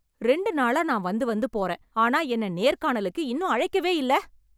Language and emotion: Tamil, angry